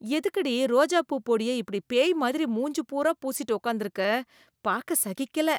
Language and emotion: Tamil, disgusted